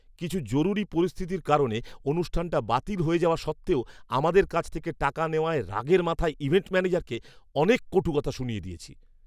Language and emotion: Bengali, angry